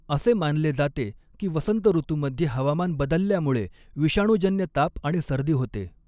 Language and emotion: Marathi, neutral